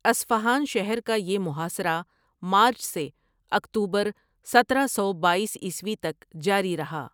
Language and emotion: Urdu, neutral